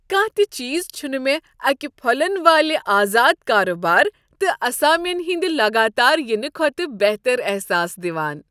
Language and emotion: Kashmiri, happy